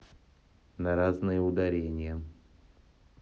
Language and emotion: Russian, neutral